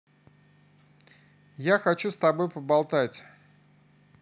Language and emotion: Russian, positive